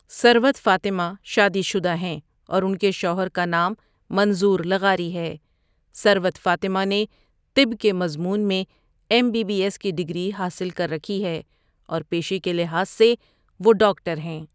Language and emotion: Urdu, neutral